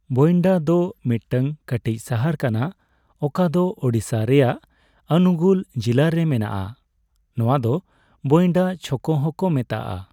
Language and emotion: Santali, neutral